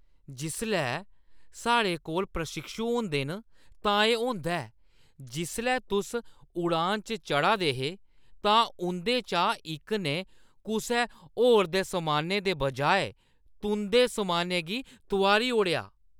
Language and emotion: Dogri, disgusted